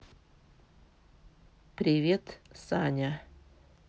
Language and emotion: Russian, neutral